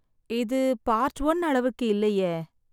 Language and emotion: Tamil, sad